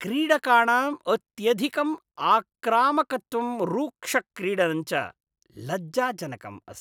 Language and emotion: Sanskrit, disgusted